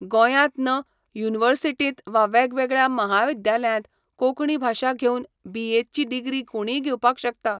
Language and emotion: Goan Konkani, neutral